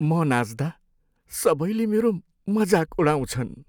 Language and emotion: Nepali, sad